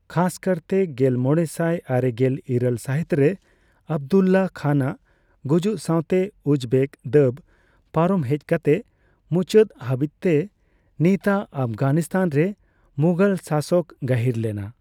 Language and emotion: Santali, neutral